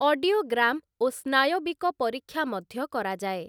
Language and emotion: Odia, neutral